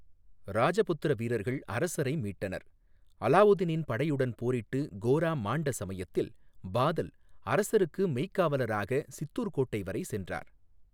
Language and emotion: Tamil, neutral